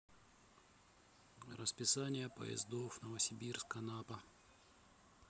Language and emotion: Russian, neutral